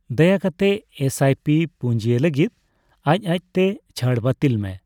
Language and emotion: Santali, neutral